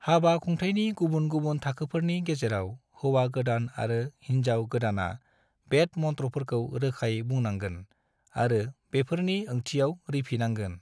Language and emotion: Bodo, neutral